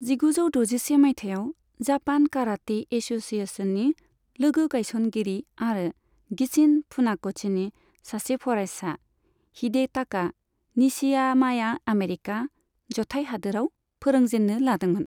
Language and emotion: Bodo, neutral